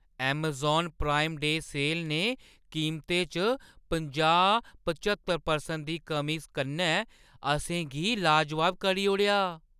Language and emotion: Dogri, surprised